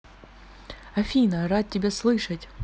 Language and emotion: Russian, positive